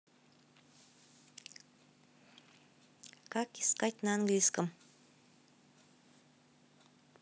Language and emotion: Russian, neutral